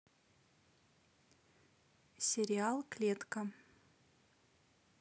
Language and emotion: Russian, neutral